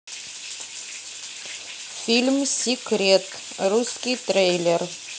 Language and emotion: Russian, neutral